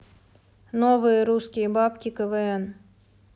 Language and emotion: Russian, neutral